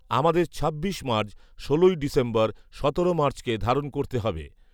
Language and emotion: Bengali, neutral